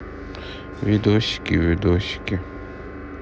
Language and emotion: Russian, sad